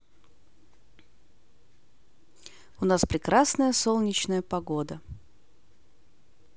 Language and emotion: Russian, positive